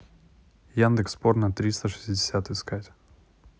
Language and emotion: Russian, neutral